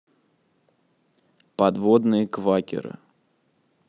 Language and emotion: Russian, neutral